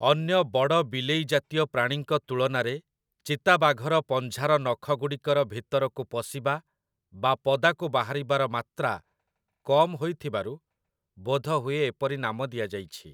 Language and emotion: Odia, neutral